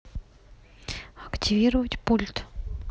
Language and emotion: Russian, neutral